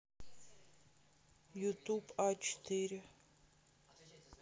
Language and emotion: Russian, neutral